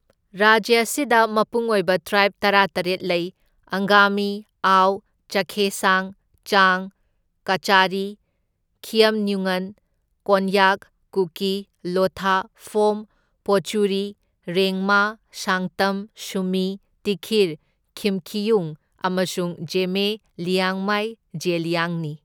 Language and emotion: Manipuri, neutral